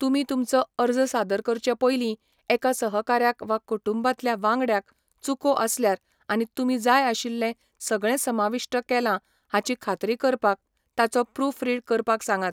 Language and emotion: Goan Konkani, neutral